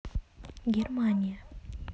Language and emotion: Russian, neutral